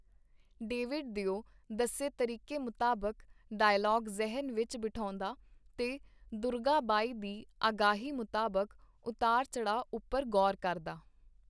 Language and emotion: Punjabi, neutral